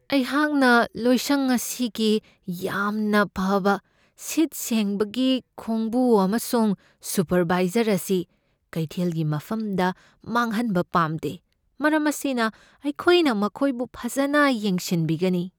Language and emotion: Manipuri, fearful